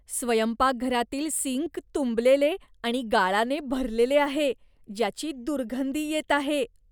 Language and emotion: Marathi, disgusted